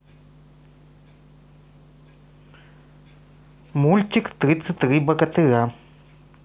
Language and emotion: Russian, neutral